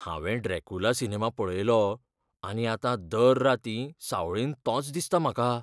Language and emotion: Goan Konkani, fearful